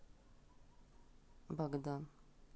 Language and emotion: Russian, neutral